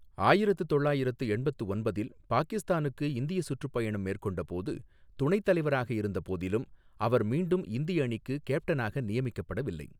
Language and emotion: Tamil, neutral